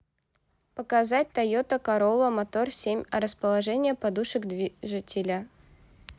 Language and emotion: Russian, neutral